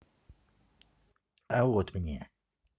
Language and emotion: Russian, neutral